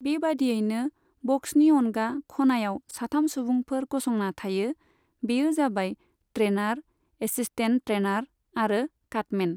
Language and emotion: Bodo, neutral